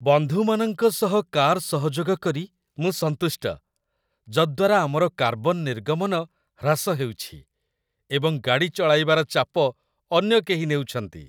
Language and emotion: Odia, happy